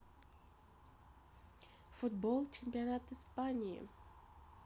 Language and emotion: Russian, neutral